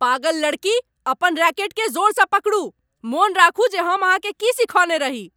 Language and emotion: Maithili, angry